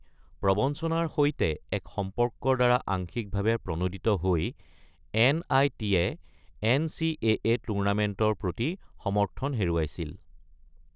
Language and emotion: Assamese, neutral